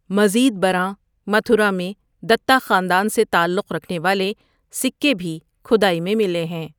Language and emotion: Urdu, neutral